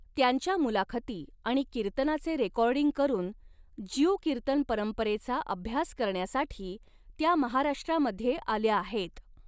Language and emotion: Marathi, neutral